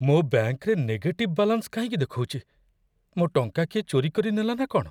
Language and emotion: Odia, fearful